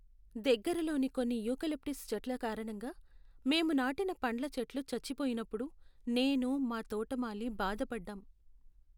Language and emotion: Telugu, sad